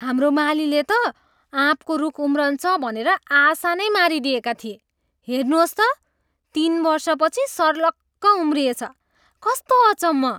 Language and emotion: Nepali, surprised